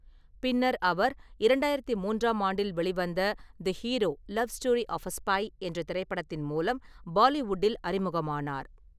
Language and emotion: Tamil, neutral